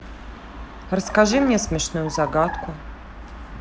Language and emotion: Russian, neutral